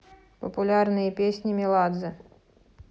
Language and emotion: Russian, neutral